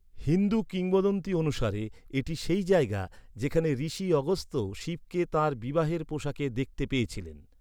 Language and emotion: Bengali, neutral